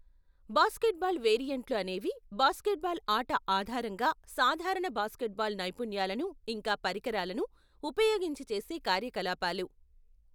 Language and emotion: Telugu, neutral